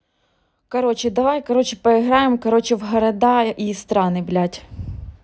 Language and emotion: Russian, neutral